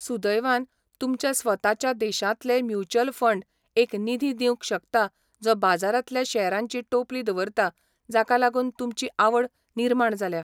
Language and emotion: Goan Konkani, neutral